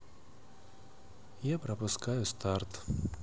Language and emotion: Russian, sad